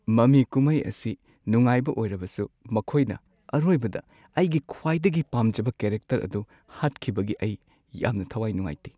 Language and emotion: Manipuri, sad